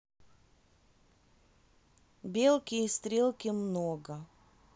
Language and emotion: Russian, neutral